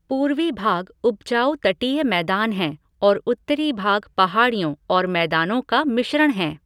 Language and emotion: Hindi, neutral